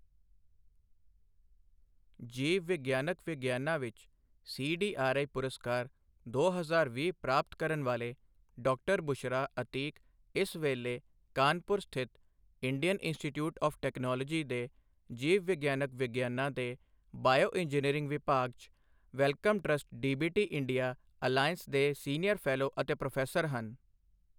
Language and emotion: Punjabi, neutral